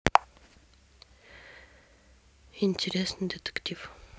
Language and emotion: Russian, neutral